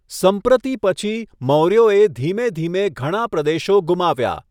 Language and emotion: Gujarati, neutral